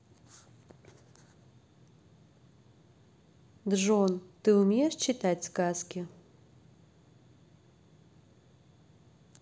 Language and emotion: Russian, neutral